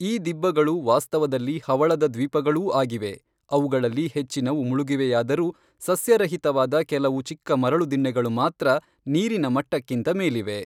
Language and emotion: Kannada, neutral